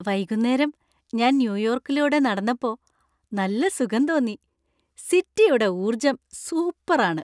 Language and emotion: Malayalam, happy